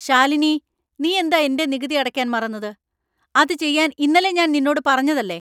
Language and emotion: Malayalam, angry